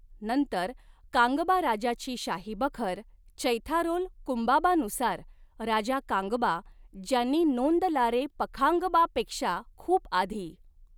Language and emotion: Marathi, neutral